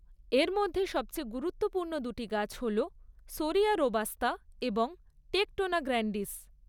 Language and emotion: Bengali, neutral